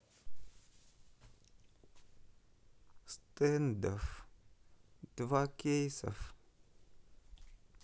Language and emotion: Russian, sad